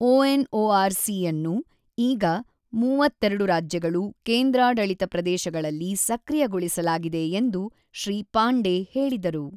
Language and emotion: Kannada, neutral